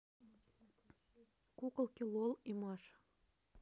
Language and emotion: Russian, neutral